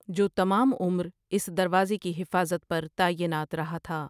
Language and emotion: Urdu, neutral